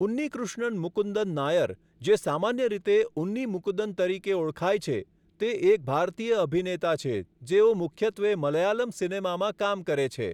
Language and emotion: Gujarati, neutral